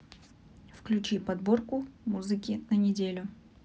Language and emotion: Russian, neutral